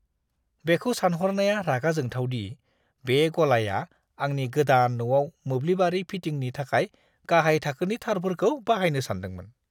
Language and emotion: Bodo, disgusted